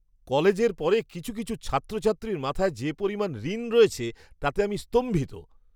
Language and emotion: Bengali, surprised